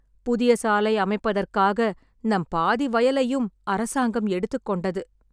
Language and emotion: Tamil, sad